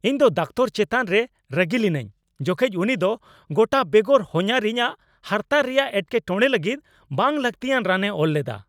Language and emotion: Santali, angry